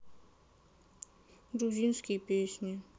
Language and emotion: Russian, sad